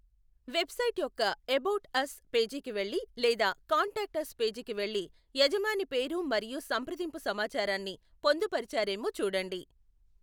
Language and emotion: Telugu, neutral